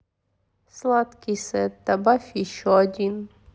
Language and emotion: Russian, sad